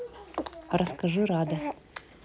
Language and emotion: Russian, neutral